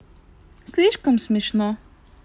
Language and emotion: Russian, neutral